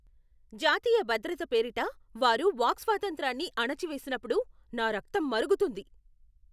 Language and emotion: Telugu, angry